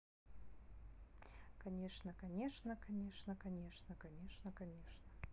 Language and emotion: Russian, neutral